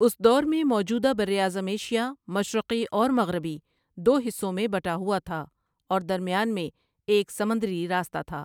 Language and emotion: Urdu, neutral